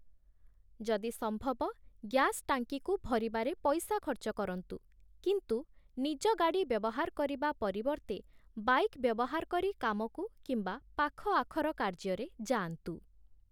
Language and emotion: Odia, neutral